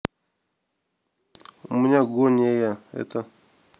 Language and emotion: Russian, neutral